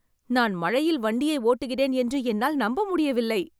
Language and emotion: Tamil, surprised